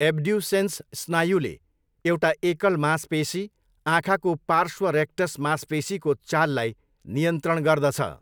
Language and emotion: Nepali, neutral